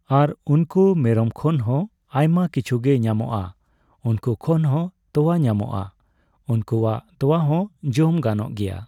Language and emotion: Santali, neutral